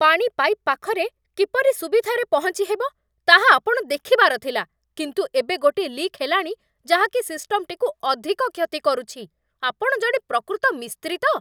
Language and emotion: Odia, angry